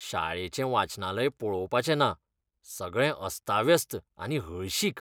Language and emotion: Goan Konkani, disgusted